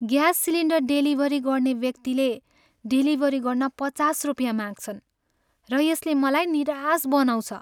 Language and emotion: Nepali, sad